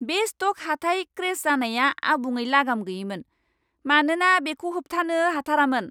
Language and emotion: Bodo, angry